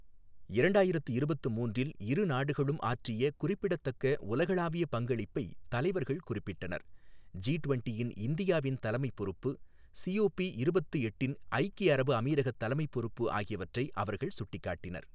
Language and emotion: Tamil, neutral